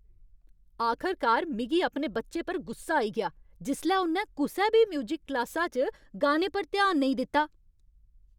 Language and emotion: Dogri, angry